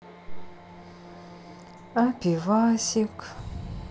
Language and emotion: Russian, sad